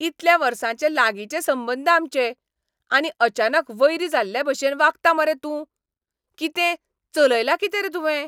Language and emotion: Goan Konkani, angry